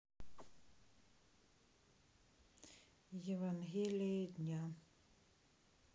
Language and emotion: Russian, neutral